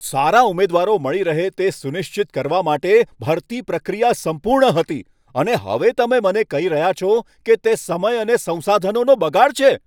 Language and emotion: Gujarati, angry